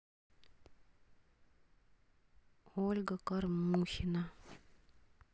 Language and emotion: Russian, sad